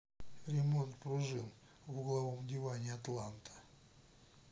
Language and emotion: Russian, neutral